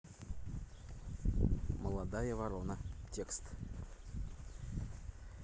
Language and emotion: Russian, neutral